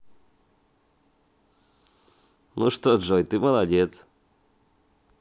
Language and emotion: Russian, positive